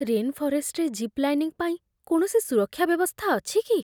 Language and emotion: Odia, fearful